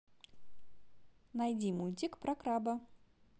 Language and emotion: Russian, positive